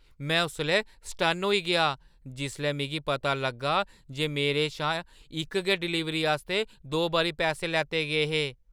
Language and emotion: Dogri, surprised